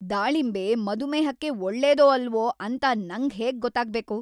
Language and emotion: Kannada, angry